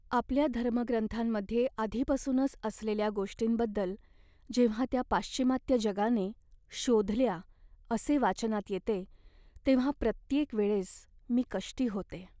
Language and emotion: Marathi, sad